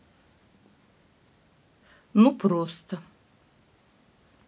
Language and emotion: Russian, neutral